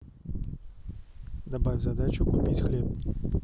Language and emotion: Russian, neutral